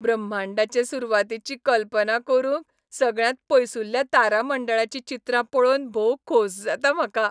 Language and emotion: Goan Konkani, happy